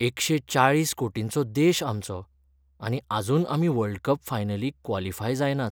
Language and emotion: Goan Konkani, sad